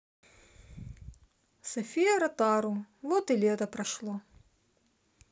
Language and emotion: Russian, neutral